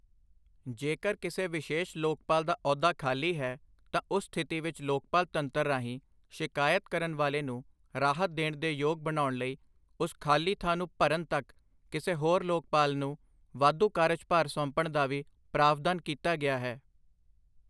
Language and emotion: Punjabi, neutral